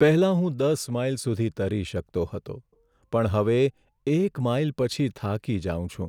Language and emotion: Gujarati, sad